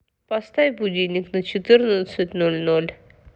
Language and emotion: Russian, neutral